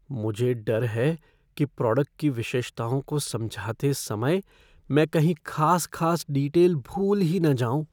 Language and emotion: Hindi, fearful